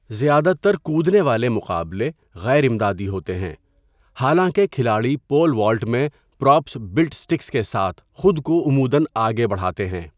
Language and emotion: Urdu, neutral